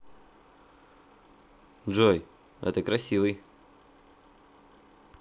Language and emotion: Russian, positive